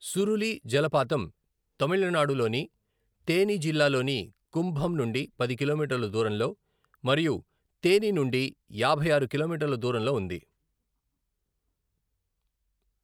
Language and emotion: Telugu, neutral